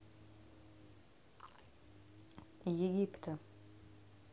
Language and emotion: Russian, neutral